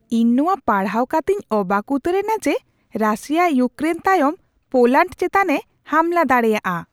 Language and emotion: Santali, surprised